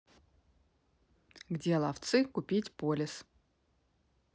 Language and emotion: Russian, neutral